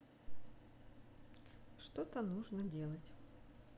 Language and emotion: Russian, neutral